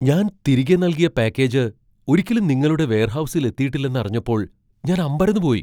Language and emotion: Malayalam, surprised